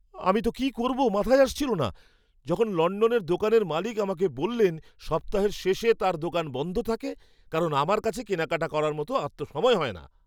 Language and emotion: Bengali, surprised